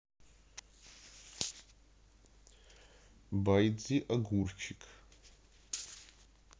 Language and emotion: Russian, neutral